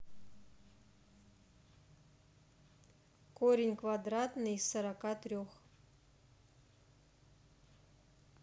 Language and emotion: Russian, neutral